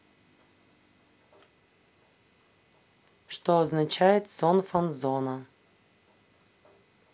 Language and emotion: Russian, neutral